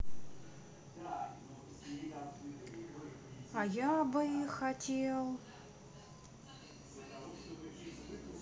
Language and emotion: Russian, neutral